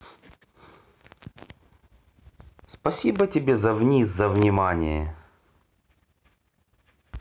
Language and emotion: Russian, neutral